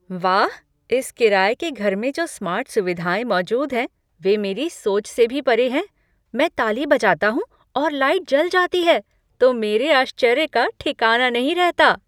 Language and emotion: Hindi, surprised